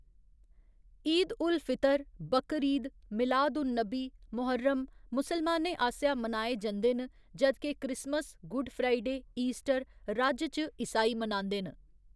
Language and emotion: Dogri, neutral